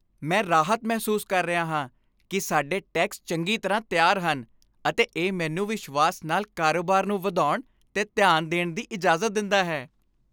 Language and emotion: Punjabi, happy